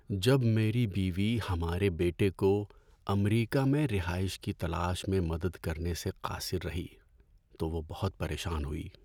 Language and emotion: Urdu, sad